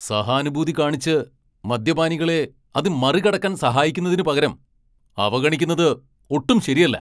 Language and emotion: Malayalam, angry